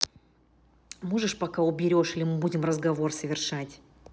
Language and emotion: Russian, angry